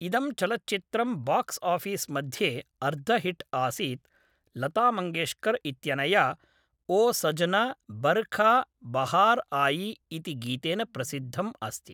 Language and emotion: Sanskrit, neutral